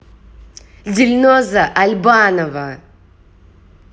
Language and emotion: Russian, angry